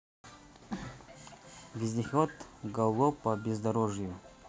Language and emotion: Russian, neutral